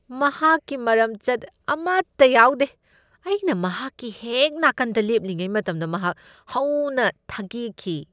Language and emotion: Manipuri, disgusted